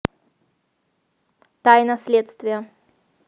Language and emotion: Russian, neutral